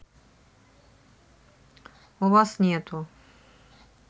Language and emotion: Russian, neutral